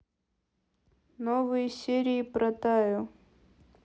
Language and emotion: Russian, neutral